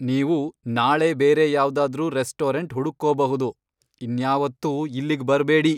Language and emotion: Kannada, angry